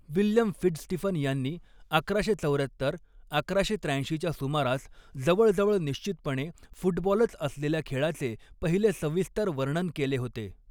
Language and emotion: Marathi, neutral